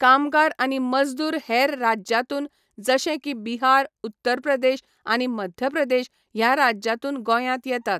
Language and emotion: Goan Konkani, neutral